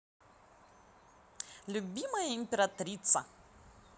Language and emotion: Russian, positive